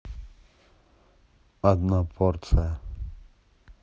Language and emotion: Russian, neutral